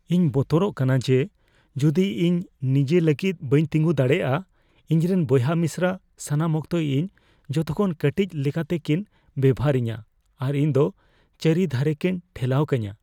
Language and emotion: Santali, fearful